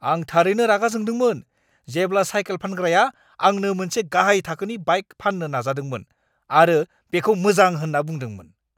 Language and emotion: Bodo, angry